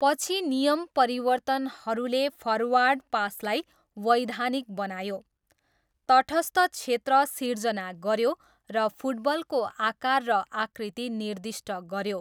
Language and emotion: Nepali, neutral